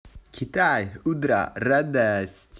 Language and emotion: Russian, positive